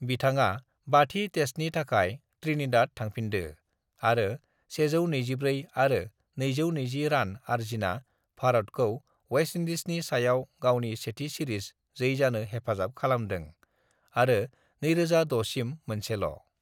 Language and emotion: Bodo, neutral